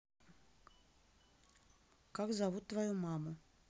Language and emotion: Russian, neutral